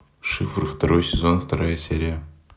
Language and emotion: Russian, neutral